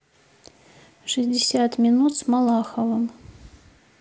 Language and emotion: Russian, neutral